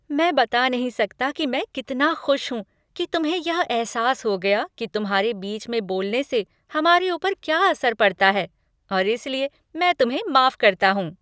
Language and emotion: Hindi, happy